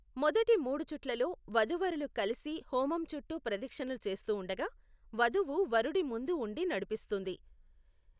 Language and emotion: Telugu, neutral